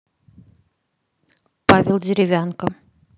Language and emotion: Russian, neutral